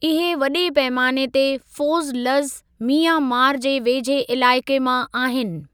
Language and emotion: Sindhi, neutral